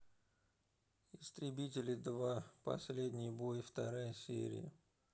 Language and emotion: Russian, neutral